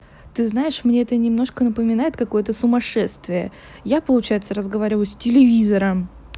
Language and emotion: Russian, neutral